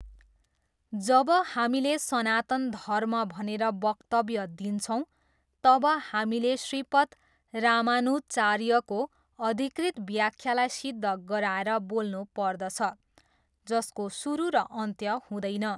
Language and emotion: Nepali, neutral